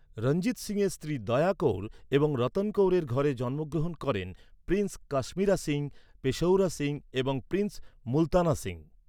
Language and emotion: Bengali, neutral